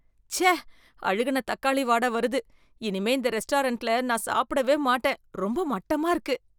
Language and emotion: Tamil, disgusted